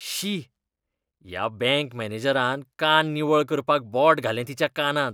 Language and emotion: Goan Konkani, disgusted